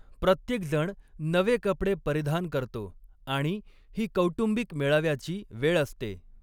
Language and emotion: Marathi, neutral